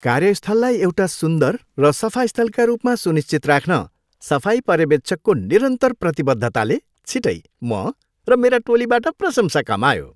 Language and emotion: Nepali, happy